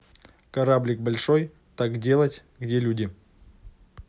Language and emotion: Russian, neutral